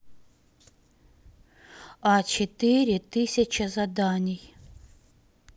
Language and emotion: Russian, neutral